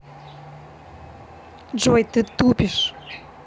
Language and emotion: Russian, angry